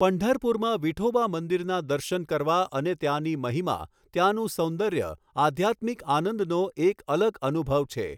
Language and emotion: Gujarati, neutral